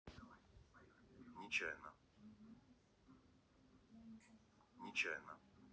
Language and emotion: Russian, neutral